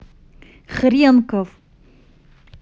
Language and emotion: Russian, angry